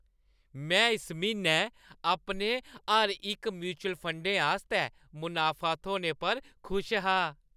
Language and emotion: Dogri, happy